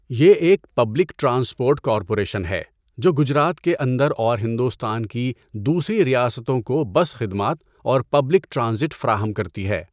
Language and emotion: Urdu, neutral